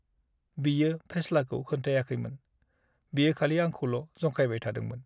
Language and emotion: Bodo, sad